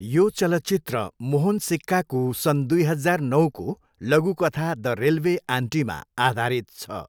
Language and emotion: Nepali, neutral